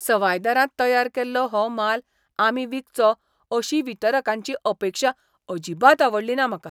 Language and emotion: Goan Konkani, disgusted